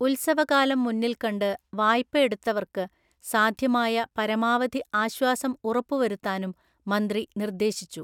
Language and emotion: Malayalam, neutral